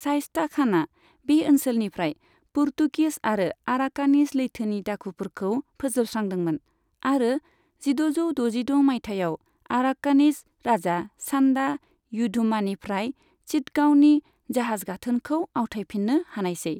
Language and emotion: Bodo, neutral